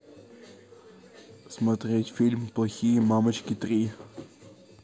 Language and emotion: Russian, neutral